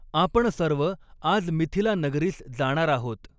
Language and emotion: Marathi, neutral